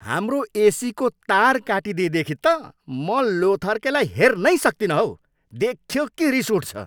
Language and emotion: Nepali, angry